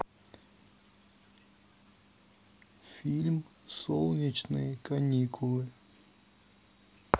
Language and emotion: Russian, neutral